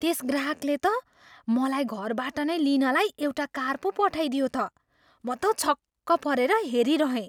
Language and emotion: Nepali, surprised